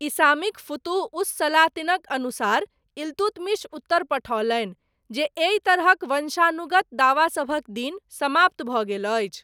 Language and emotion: Maithili, neutral